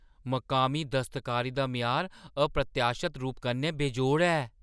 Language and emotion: Dogri, surprised